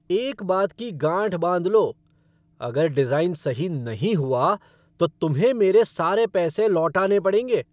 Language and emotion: Hindi, angry